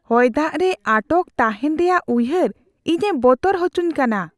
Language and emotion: Santali, fearful